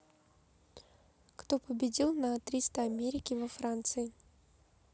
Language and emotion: Russian, neutral